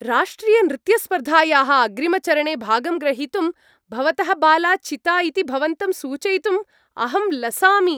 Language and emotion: Sanskrit, happy